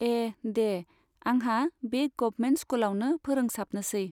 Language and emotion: Bodo, neutral